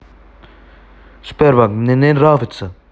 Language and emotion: Russian, angry